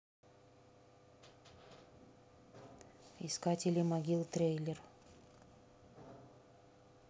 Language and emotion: Russian, neutral